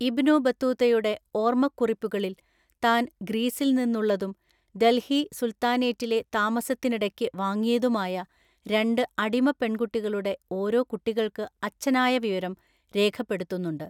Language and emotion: Malayalam, neutral